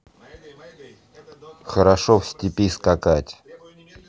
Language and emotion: Russian, neutral